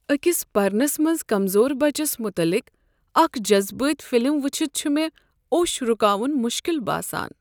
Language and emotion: Kashmiri, sad